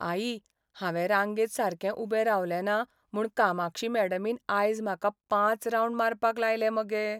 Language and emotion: Goan Konkani, sad